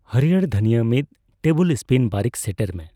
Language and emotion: Santali, neutral